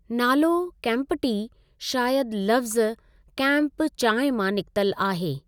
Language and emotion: Sindhi, neutral